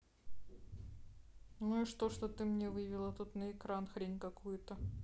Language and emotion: Russian, neutral